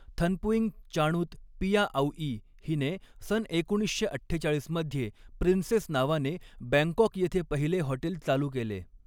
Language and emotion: Marathi, neutral